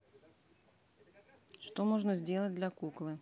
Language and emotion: Russian, neutral